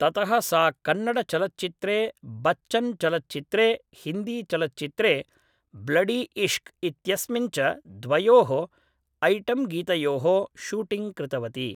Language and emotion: Sanskrit, neutral